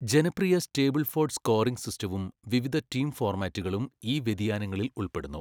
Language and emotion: Malayalam, neutral